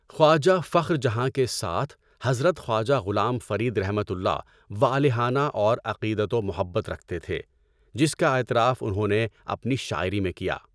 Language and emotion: Urdu, neutral